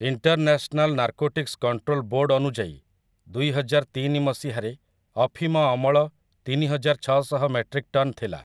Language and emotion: Odia, neutral